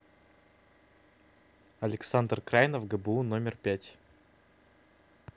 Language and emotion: Russian, neutral